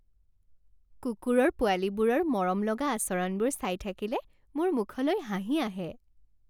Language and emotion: Assamese, happy